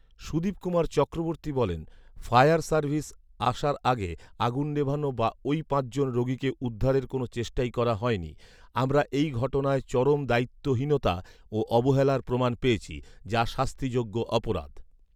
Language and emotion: Bengali, neutral